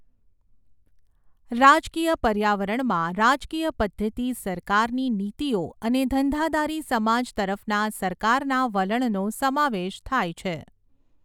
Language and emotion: Gujarati, neutral